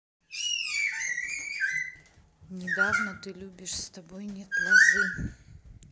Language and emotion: Russian, neutral